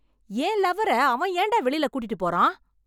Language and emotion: Tamil, angry